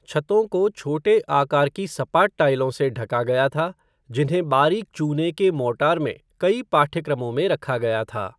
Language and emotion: Hindi, neutral